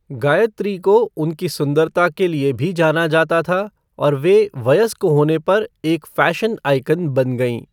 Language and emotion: Hindi, neutral